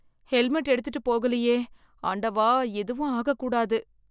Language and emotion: Tamil, fearful